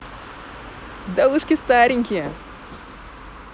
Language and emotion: Russian, positive